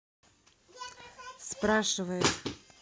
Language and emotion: Russian, neutral